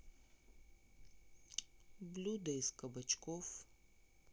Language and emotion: Russian, neutral